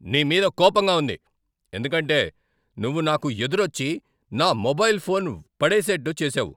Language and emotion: Telugu, angry